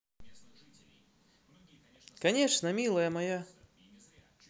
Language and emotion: Russian, positive